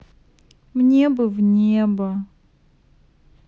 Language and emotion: Russian, sad